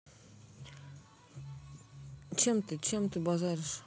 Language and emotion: Russian, neutral